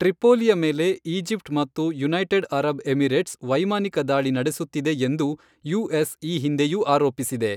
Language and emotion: Kannada, neutral